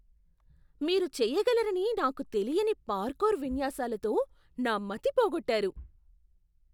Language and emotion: Telugu, surprised